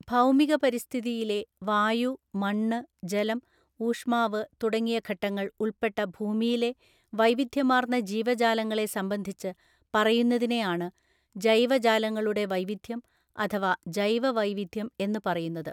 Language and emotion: Malayalam, neutral